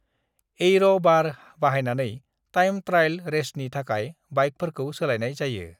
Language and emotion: Bodo, neutral